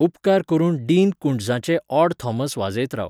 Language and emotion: Goan Konkani, neutral